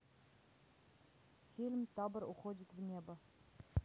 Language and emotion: Russian, neutral